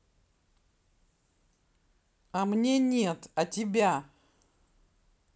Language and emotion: Russian, angry